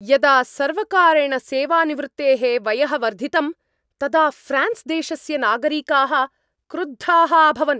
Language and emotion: Sanskrit, angry